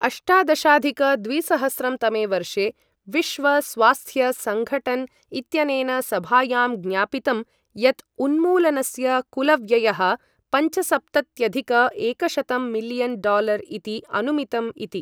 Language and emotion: Sanskrit, neutral